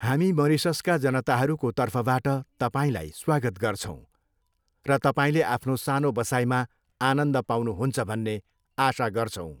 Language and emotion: Nepali, neutral